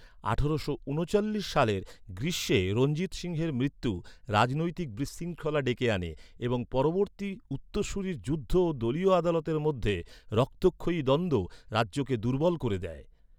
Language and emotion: Bengali, neutral